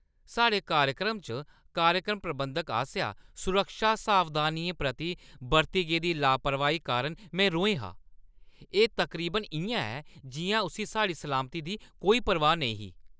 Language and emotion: Dogri, angry